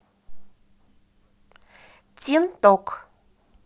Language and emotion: Russian, positive